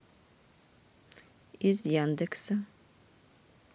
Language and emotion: Russian, neutral